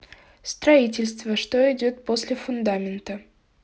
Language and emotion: Russian, neutral